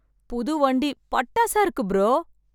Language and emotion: Tamil, happy